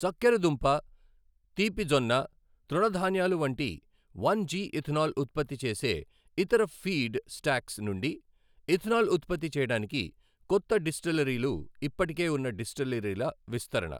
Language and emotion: Telugu, neutral